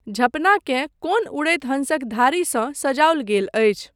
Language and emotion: Maithili, neutral